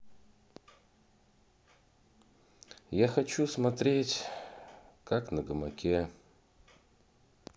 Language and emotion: Russian, sad